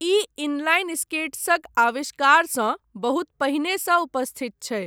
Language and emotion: Maithili, neutral